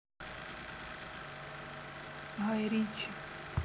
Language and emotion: Russian, sad